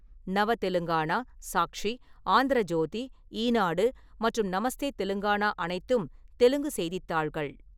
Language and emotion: Tamil, neutral